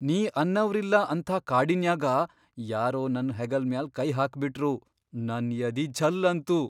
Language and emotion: Kannada, surprised